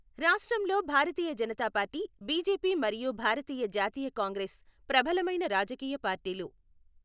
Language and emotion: Telugu, neutral